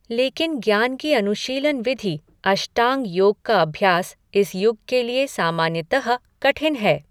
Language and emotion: Hindi, neutral